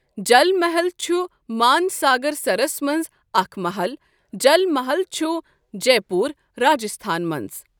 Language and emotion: Kashmiri, neutral